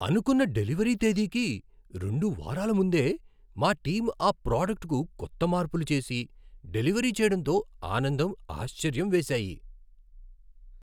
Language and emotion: Telugu, surprised